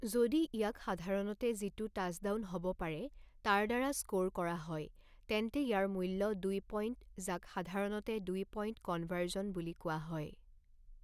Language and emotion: Assamese, neutral